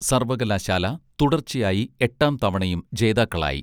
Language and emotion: Malayalam, neutral